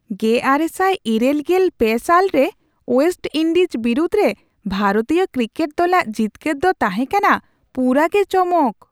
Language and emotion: Santali, surprised